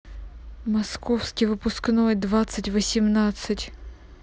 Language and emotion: Russian, neutral